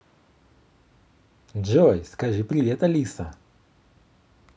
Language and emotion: Russian, positive